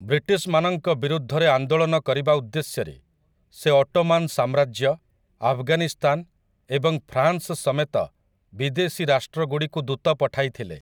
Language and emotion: Odia, neutral